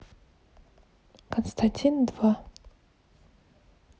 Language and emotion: Russian, neutral